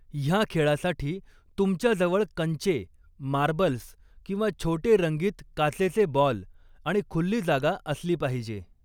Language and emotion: Marathi, neutral